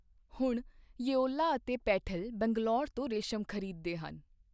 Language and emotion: Punjabi, neutral